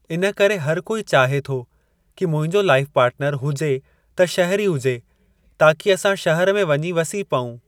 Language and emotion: Sindhi, neutral